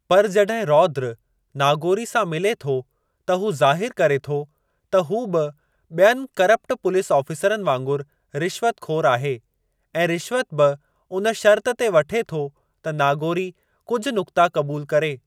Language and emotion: Sindhi, neutral